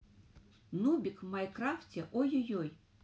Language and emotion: Russian, neutral